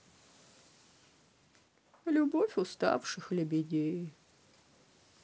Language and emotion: Russian, sad